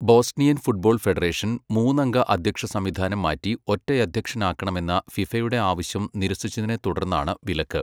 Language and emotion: Malayalam, neutral